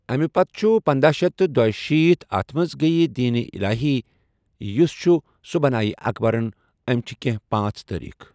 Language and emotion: Kashmiri, neutral